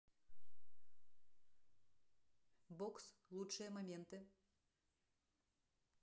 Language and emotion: Russian, neutral